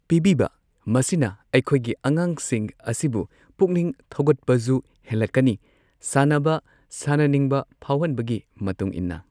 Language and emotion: Manipuri, neutral